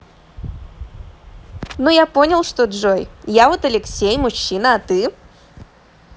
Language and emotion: Russian, positive